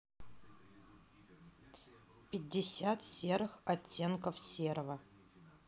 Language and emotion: Russian, neutral